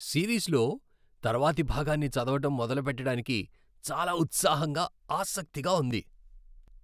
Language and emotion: Telugu, happy